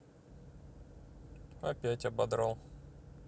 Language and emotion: Russian, neutral